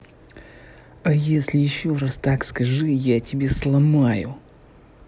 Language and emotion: Russian, angry